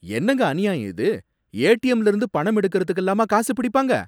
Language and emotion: Tamil, angry